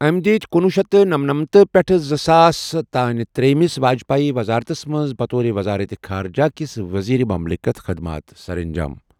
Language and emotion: Kashmiri, neutral